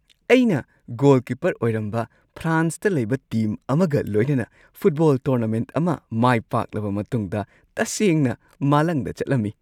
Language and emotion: Manipuri, happy